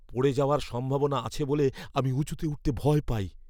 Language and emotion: Bengali, fearful